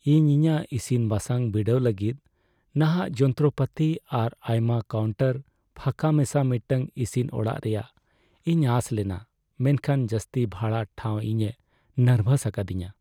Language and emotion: Santali, sad